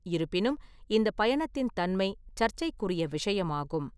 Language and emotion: Tamil, neutral